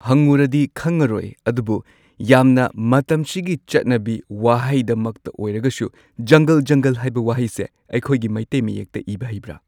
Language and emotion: Manipuri, neutral